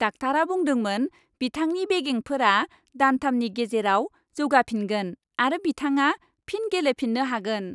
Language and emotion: Bodo, happy